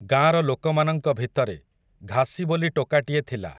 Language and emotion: Odia, neutral